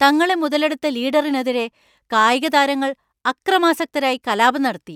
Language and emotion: Malayalam, angry